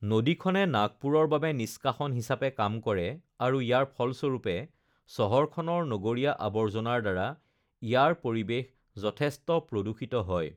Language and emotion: Assamese, neutral